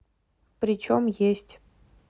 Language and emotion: Russian, neutral